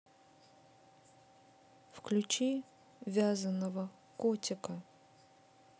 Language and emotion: Russian, neutral